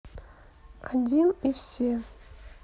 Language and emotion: Russian, neutral